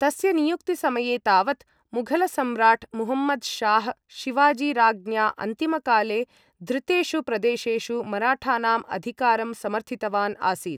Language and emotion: Sanskrit, neutral